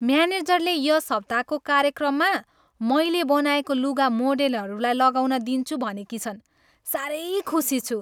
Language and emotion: Nepali, happy